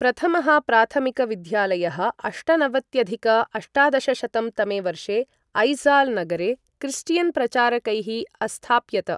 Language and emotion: Sanskrit, neutral